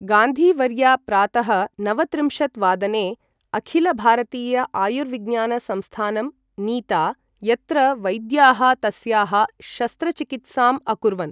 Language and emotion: Sanskrit, neutral